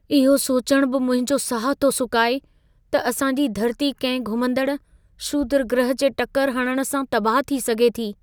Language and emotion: Sindhi, fearful